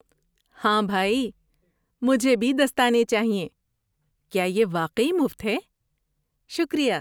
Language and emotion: Urdu, happy